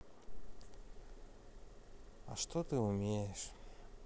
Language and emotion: Russian, sad